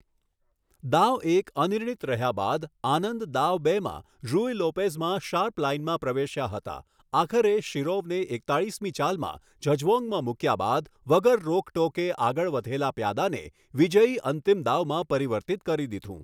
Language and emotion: Gujarati, neutral